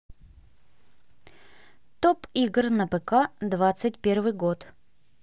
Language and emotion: Russian, neutral